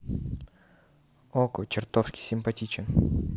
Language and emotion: Russian, neutral